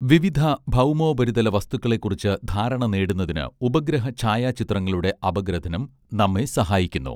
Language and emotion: Malayalam, neutral